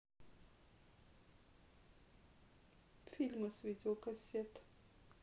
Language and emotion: Russian, sad